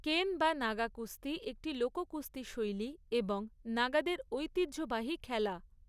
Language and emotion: Bengali, neutral